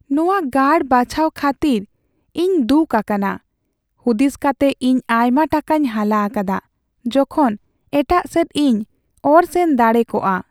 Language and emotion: Santali, sad